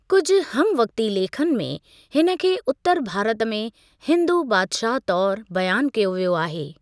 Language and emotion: Sindhi, neutral